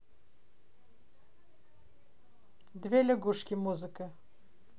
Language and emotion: Russian, neutral